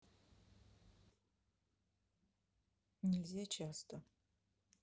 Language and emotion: Russian, neutral